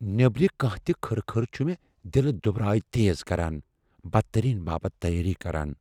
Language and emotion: Kashmiri, fearful